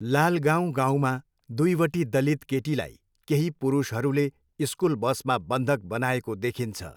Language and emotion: Nepali, neutral